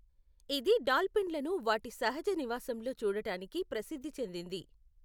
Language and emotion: Telugu, neutral